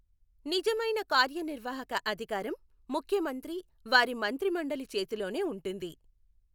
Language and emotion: Telugu, neutral